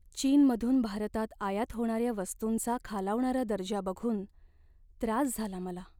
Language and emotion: Marathi, sad